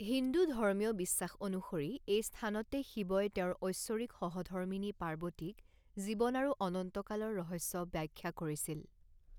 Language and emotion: Assamese, neutral